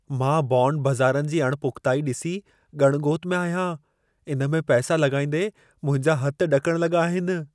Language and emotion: Sindhi, fearful